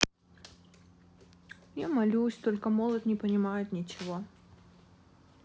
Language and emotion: Russian, sad